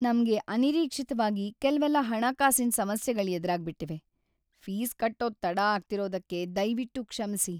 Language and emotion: Kannada, sad